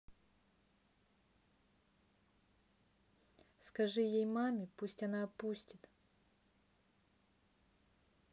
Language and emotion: Russian, neutral